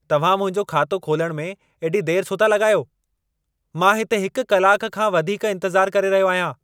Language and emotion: Sindhi, angry